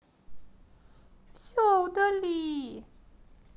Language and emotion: Russian, sad